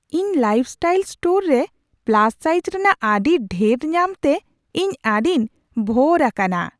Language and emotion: Santali, surprised